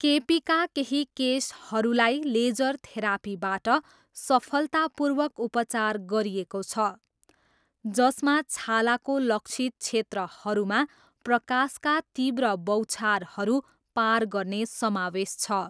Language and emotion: Nepali, neutral